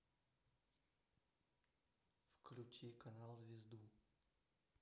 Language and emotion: Russian, neutral